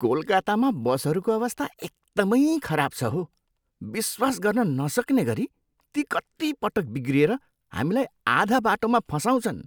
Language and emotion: Nepali, disgusted